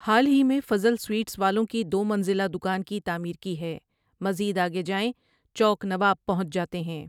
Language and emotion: Urdu, neutral